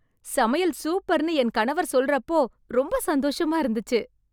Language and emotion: Tamil, happy